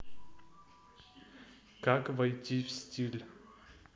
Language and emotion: Russian, neutral